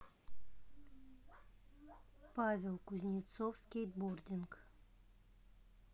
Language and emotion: Russian, neutral